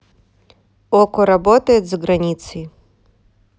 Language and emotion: Russian, neutral